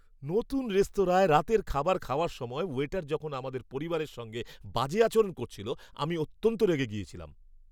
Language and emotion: Bengali, angry